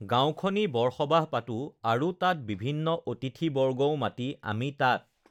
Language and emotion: Assamese, neutral